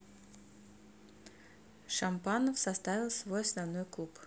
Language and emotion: Russian, neutral